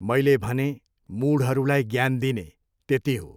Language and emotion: Nepali, neutral